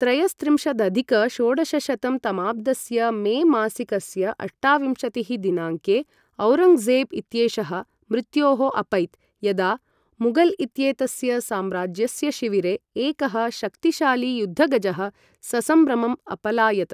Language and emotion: Sanskrit, neutral